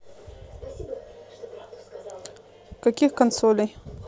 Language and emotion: Russian, neutral